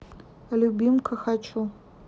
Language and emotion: Russian, neutral